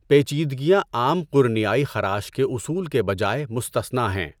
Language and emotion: Urdu, neutral